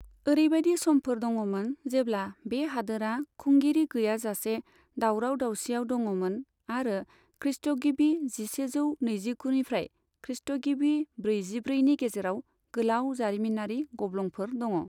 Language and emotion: Bodo, neutral